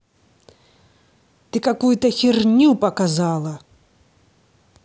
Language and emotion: Russian, angry